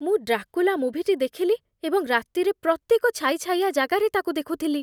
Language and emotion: Odia, fearful